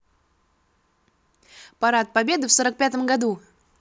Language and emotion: Russian, positive